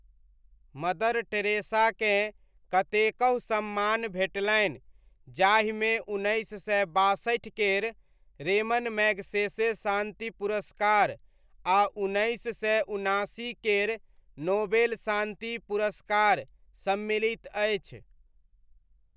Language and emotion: Maithili, neutral